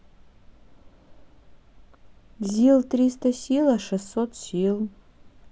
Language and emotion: Russian, neutral